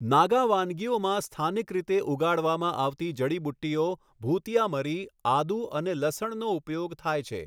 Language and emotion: Gujarati, neutral